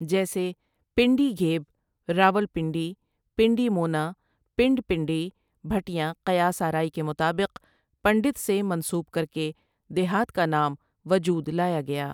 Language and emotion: Urdu, neutral